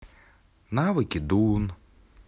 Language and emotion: Russian, neutral